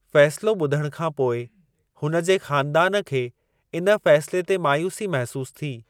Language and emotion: Sindhi, neutral